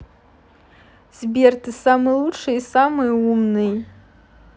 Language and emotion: Russian, positive